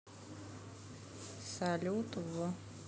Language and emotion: Russian, neutral